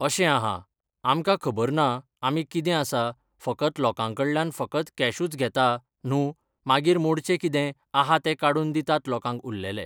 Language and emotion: Goan Konkani, neutral